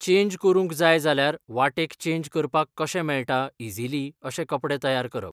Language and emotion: Goan Konkani, neutral